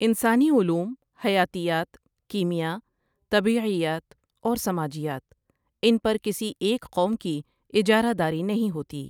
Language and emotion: Urdu, neutral